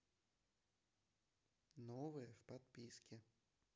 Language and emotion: Russian, neutral